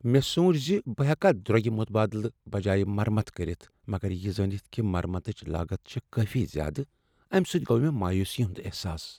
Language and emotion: Kashmiri, sad